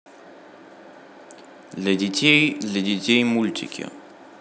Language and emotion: Russian, neutral